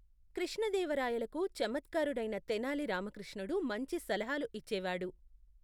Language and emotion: Telugu, neutral